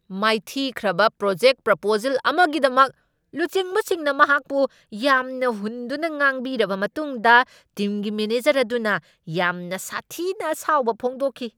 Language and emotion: Manipuri, angry